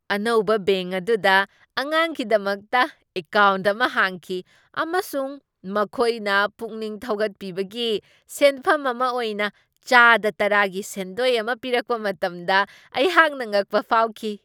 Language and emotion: Manipuri, surprised